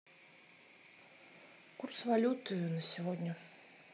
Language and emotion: Russian, neutral